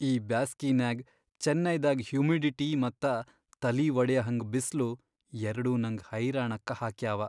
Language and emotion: Kannada, sad